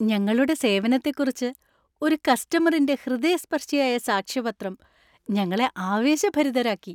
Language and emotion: Malayalam, happy